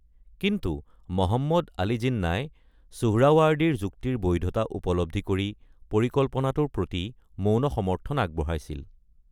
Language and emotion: Assamese, neutral